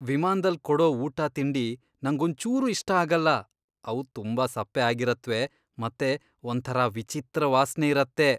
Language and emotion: Kannada, disgusted